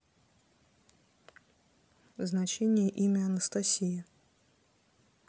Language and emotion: Russian, neutral